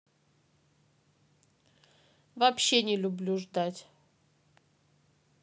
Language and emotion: Russian, neutral